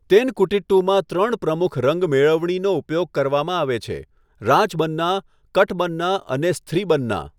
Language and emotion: Gujarati, neutral